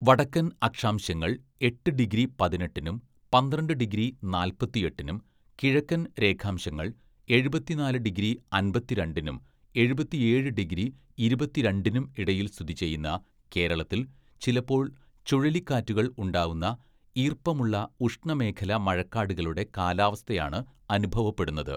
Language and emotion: Malayalam, neutral